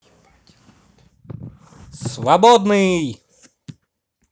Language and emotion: Russian, positive